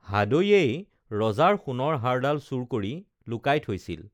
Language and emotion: Assamese, neutral